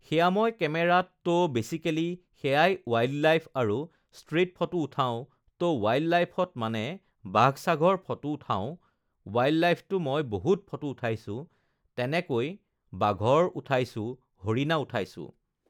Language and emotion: Assamese, neutral